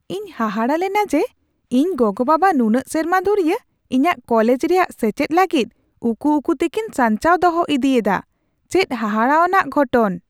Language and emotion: Santali, surprised